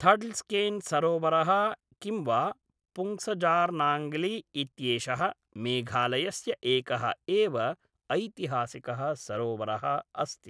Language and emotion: Sanskrit, neutral